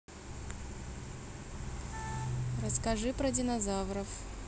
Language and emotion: Russian, neutral